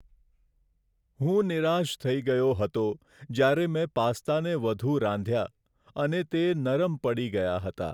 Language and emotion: Gujarati, sad